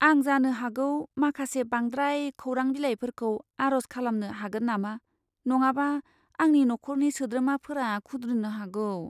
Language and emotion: Bodo, fearful